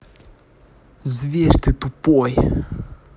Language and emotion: Russian, angry